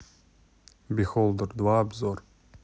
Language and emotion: Russian, neutral